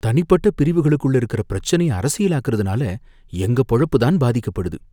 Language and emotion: Tamil, fearful